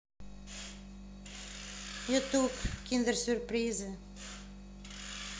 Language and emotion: Russian, neutral